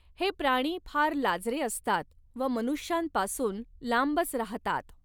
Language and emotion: Marathi, neutral